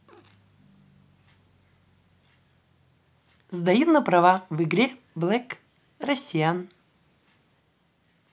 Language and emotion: Russian, positive